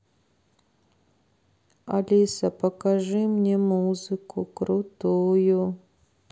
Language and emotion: Russian, sad